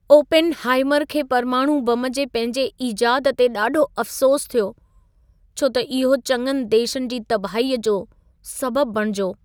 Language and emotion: Sindhi, sad